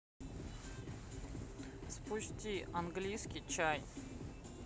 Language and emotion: Russian, neutral